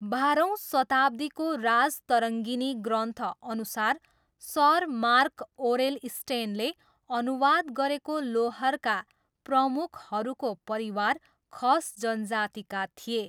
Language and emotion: Nepali, neutral